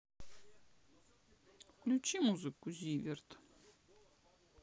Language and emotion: Russian, sad